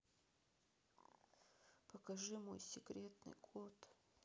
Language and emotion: Russian, sad